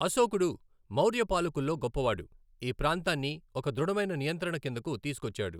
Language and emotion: Telugu, neutral